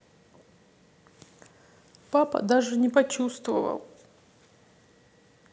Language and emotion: Russian, sad